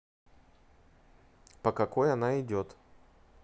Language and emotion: Russian, neutral